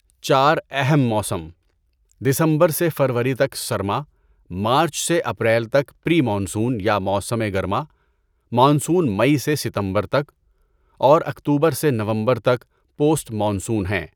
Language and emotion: Urdu, neutral